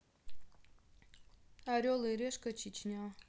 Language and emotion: Russian, neutral